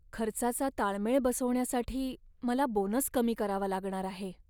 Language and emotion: Marathi, sad